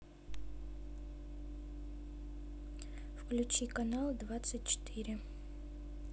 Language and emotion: Russian, neutral